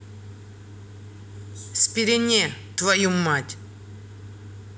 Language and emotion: Russian, angry